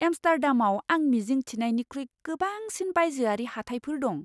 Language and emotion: Bodo, surprised